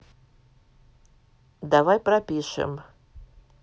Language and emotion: Russian, neutral